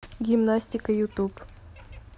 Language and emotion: Russian, neutral